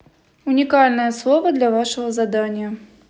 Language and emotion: Russian, neutral